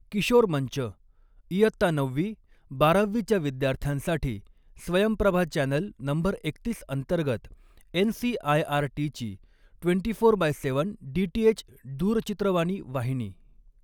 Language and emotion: Marathi, neutral